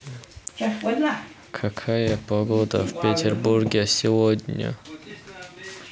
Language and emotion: Russian, neutral